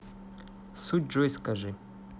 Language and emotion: Russian, neutral